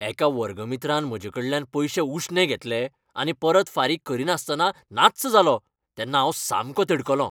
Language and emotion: Goan Konkani, angry